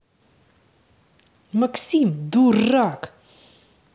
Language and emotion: Russian, angry